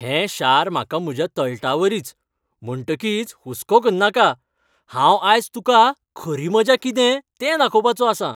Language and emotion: Goan Konkani, happy